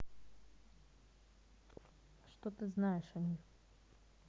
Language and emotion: Russian, neutral